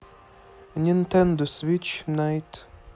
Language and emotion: Russian, neutral